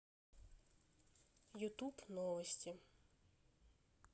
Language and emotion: Russian, neutral